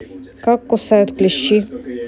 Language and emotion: Russian, neutral